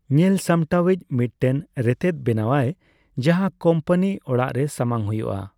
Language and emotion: Santali, neutral